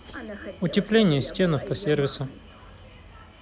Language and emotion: Russian, neutral